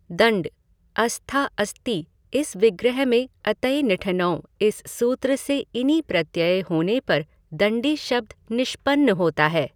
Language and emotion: Hindi, neutral